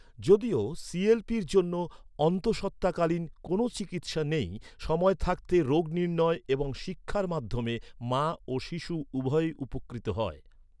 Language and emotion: Bengali, neutral